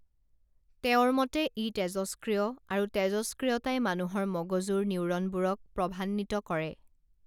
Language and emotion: Assamese, neutral